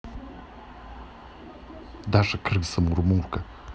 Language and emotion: Russian, neutral